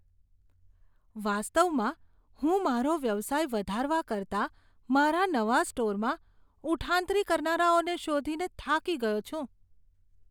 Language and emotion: Gujarati, disgusted